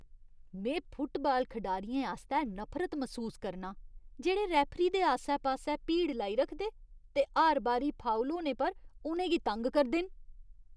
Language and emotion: Dogri, disgusted